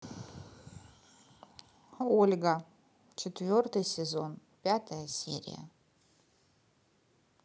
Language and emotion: Russian, neutral